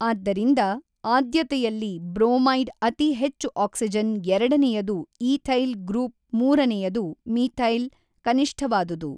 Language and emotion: Kannada, neutral